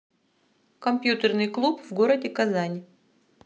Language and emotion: Russian, neutral